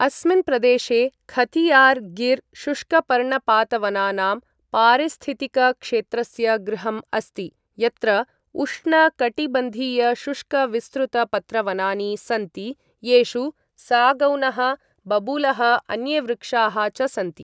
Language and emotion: Sanskrit, neutral